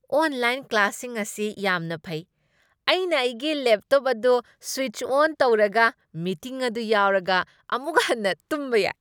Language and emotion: Manipuri, happy